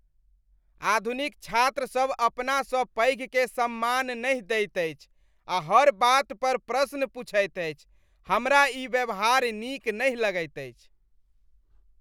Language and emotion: Maithili, disgusted